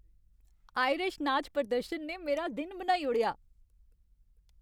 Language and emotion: Dogri, happy